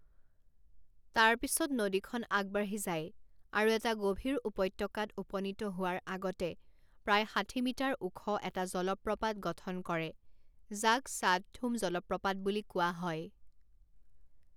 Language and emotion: Assamese, neutral